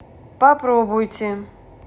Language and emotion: Russian, neutral